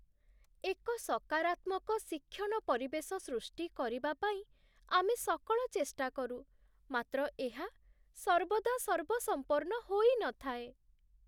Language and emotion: Odia, sad